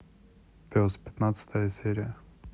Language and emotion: Russian, neutral